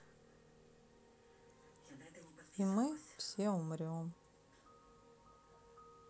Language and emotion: Russian, sad